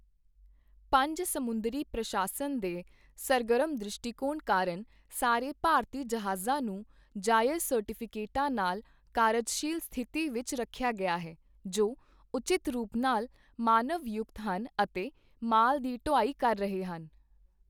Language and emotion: Punjabi, neutral